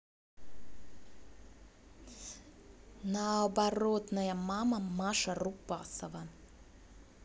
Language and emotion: Russian, angry